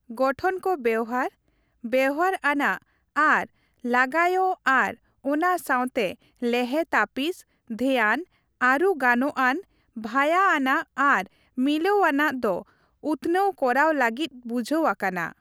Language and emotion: Santali, neutral